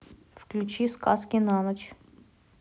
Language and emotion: Russian, neutral